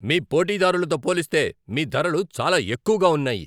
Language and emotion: Telugu, angry